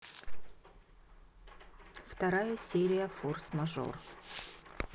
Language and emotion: Russian, neutral